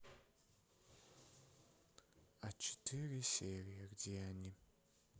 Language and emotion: Russian, sad